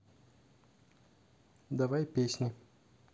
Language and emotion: Russian, neutral